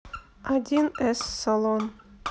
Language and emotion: Russian, neutral